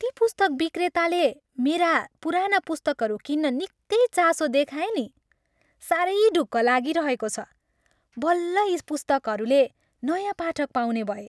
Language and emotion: Nepali, happy